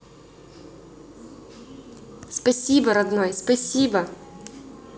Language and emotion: Russian, positive